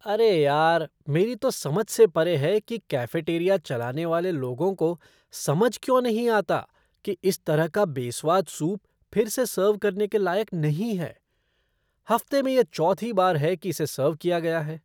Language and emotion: Hindi, disgusted